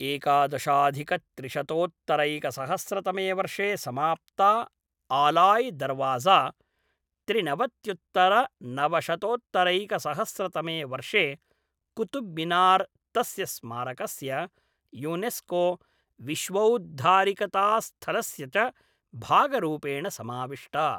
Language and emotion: Sanskrit, neutral